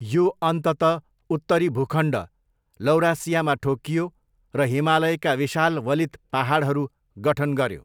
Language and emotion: Nepali, neutral